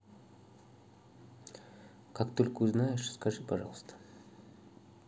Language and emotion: Russian, neutral